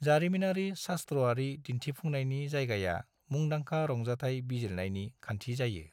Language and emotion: Bodo, neutral